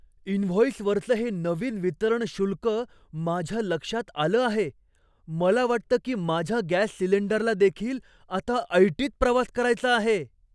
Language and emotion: Marathi, surprised